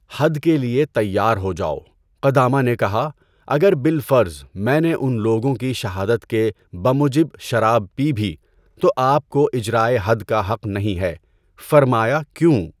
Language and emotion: Urdu, neutral